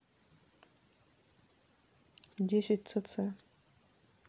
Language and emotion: Russian, neutral